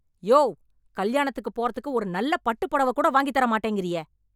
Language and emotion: Tamil, angry